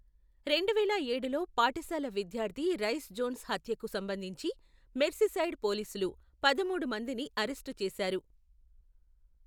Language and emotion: Telugu, neutral